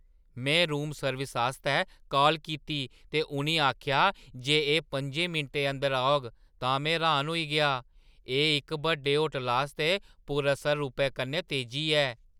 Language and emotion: Dogri, surprised